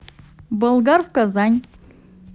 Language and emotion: Russian, positive